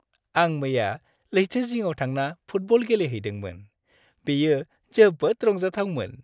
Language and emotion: Bodo, happy